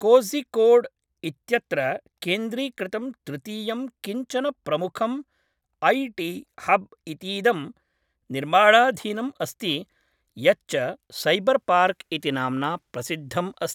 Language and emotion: Sanskrit, neutral